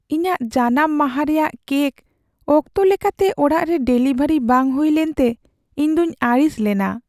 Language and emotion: Santali, sad